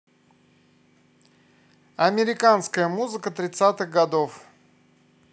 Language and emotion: Russian, positive